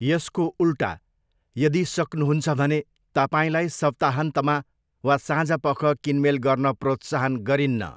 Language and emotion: Nepali, neutral